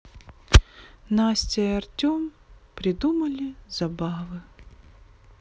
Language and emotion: Russian, neutral